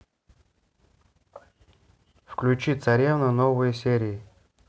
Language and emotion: Russian, neutral